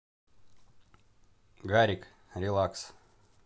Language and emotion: Russian, neutral